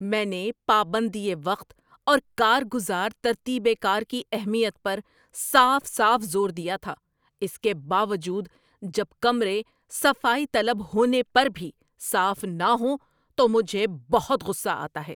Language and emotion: Urdu, angry